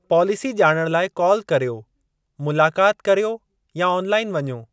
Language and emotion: Sindhi, neutral